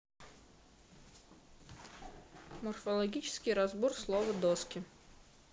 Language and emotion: Russian, neutral